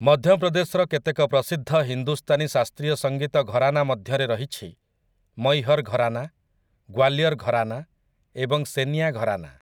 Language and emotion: Odia, neutral